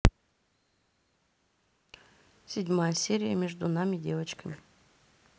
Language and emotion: Russian, neutral